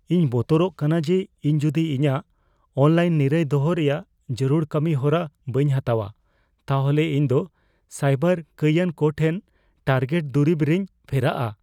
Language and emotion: Santali, fearful